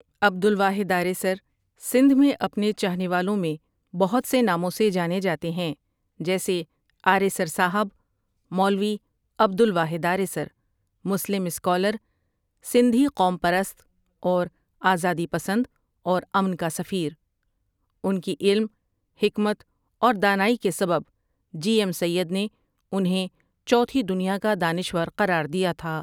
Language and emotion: Urdu, neutral